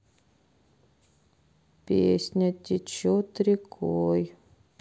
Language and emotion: Russian, sad